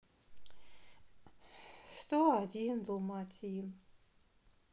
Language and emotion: Russian, sad